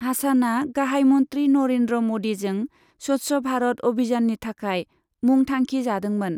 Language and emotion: Bodo, neutral